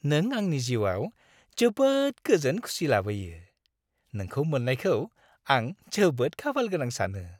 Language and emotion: Bodo, happy